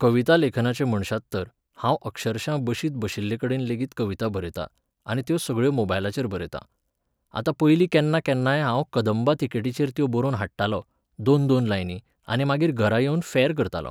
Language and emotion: Goan Konkani, neutral